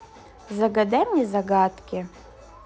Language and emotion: Russian, positive